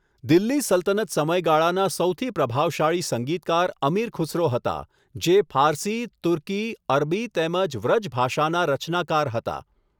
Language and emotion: Gujarati, neutral